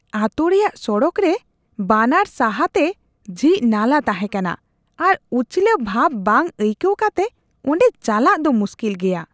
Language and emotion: Santali, disgusted